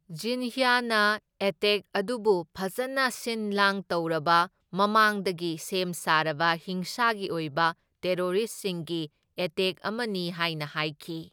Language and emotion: Manipuri, neutral